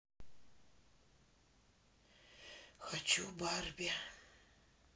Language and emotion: Russian, sad